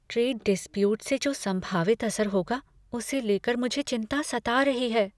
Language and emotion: Hindi, fearful